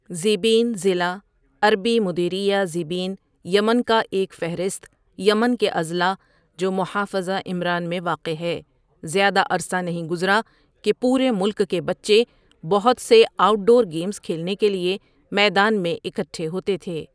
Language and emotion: Urdu, neutral